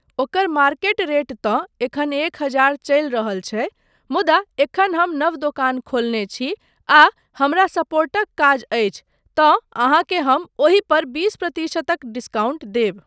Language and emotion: Maithili, neutral